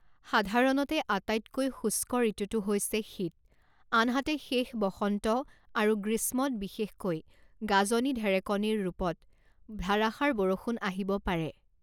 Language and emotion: Assamese, neutral